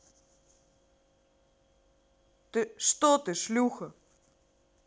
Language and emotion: Russian, angry